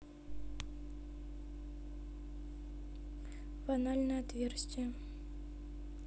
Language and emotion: Russian, neutral